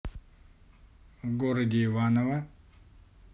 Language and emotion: Russian, neutral